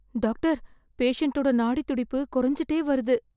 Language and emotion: Tamil, fearful